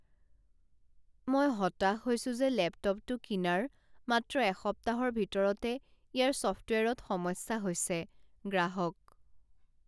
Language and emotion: Assamese, sad